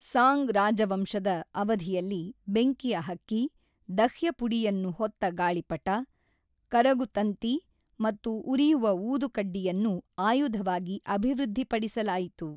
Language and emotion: Kannada, neutral